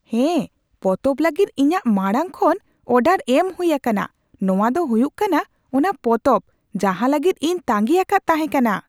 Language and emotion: Santali, surprised